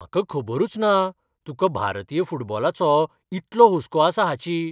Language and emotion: Goan Konkani, surprised